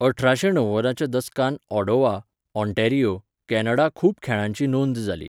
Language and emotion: Goan Konkani, neutral